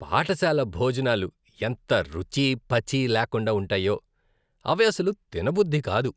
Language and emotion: Telugu, disgusted